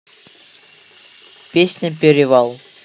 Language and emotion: Russian, neutral